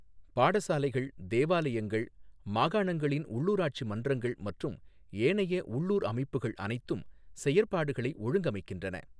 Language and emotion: Tamil, neutral